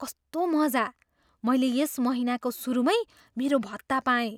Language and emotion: Nepali, surprised